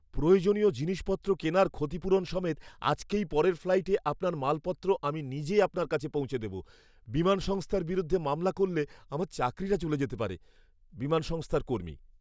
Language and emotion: Bengali, fearful